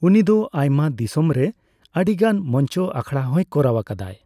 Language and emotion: Santali, neutral